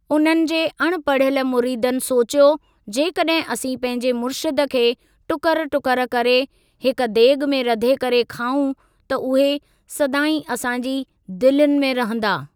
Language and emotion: Sindhi, neutral